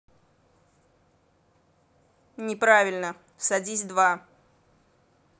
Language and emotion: Russian, angry